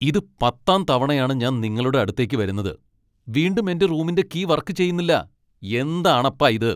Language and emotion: Malayalam, angry